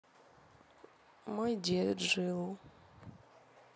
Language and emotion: Russian, sad